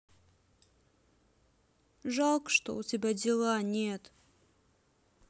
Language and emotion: Russian, neutral